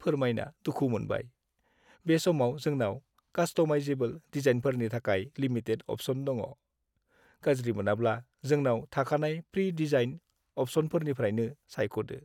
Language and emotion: Bodo, sad